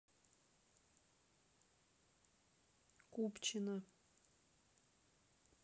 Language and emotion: Russian, neutral